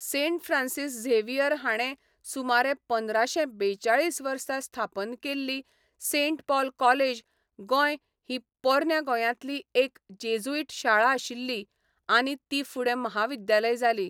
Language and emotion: Goan Konkani, neutral